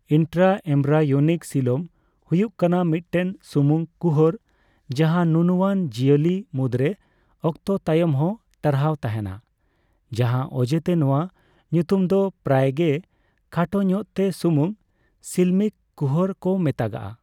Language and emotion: Santali, neutral